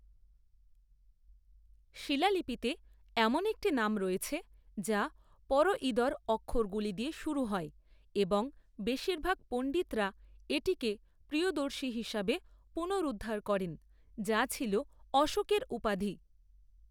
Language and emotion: Bengali, neutral